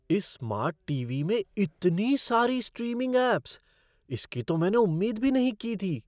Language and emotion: Hindi, surprised